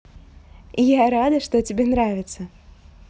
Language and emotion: Russian, positive